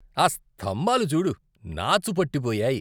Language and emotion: Telugu, disgusted